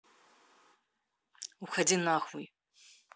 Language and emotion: Russian, angry